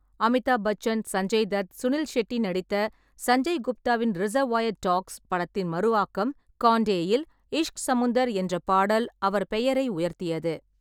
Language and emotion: Tamil, neutral